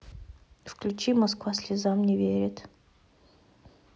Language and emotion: Russian, neutral